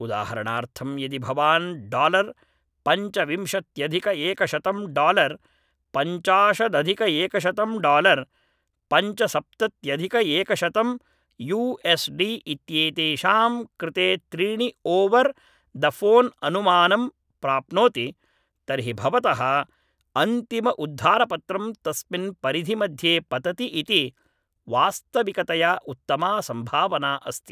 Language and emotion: Sanskrit, neutral